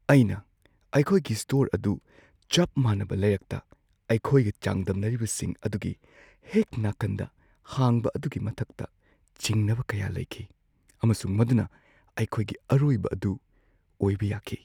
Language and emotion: Manipuri, fearful